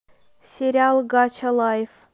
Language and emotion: Russian, neutral